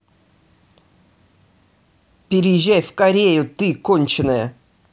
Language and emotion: Russian, angry